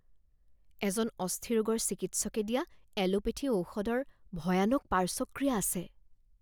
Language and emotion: Assamese, fearful